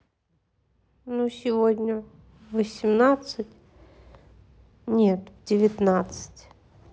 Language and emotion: Russian, neutral